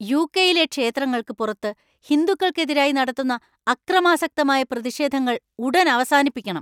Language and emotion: Malayalam, angry